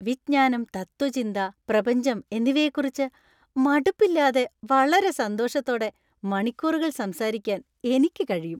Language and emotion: Malayalam, happy